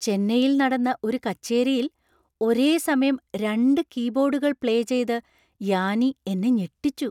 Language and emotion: Malayalam, surprised